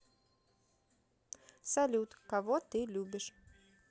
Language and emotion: Russian, neutral